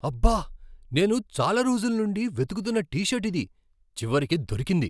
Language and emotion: Telugu, surprised